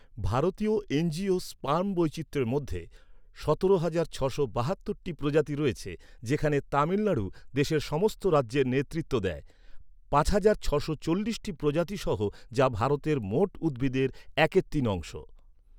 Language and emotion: Bengali, neutral